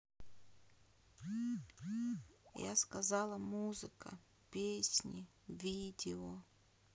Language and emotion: Russian, sad